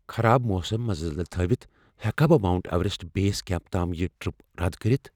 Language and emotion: Kashmiri, fearful